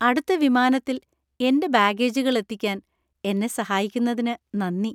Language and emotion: Malayalam, happy